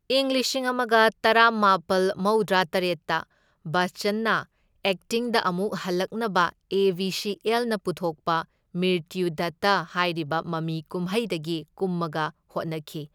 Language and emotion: Manipuri, neutral